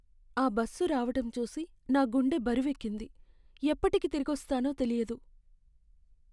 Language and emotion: Telugu, sad